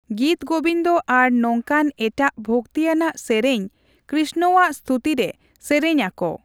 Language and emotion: Santali, neutral